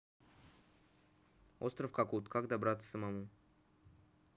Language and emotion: Russian, neutral